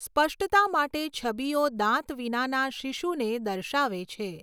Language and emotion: Gujarati, neutral